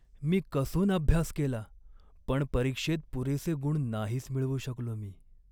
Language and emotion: Marathi, sad